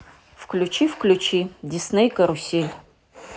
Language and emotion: Russian, neutral